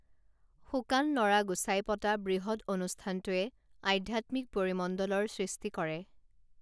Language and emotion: Assamese, neutral